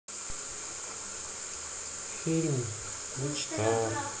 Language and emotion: Russian, sad